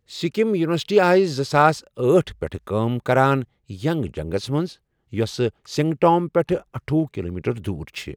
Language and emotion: Kashmiri, neutral